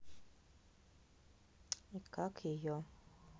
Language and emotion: Russian, neutral